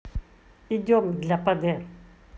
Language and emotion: Russian, neutral